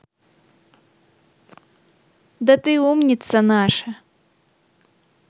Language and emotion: Russian, positive